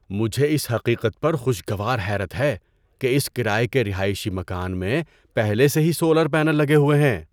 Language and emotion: Urdu, surprised